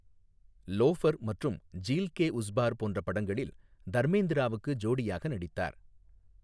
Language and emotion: Tamil, neutral